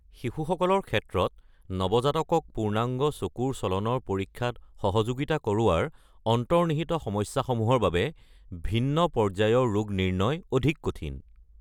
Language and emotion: Assamese, neutral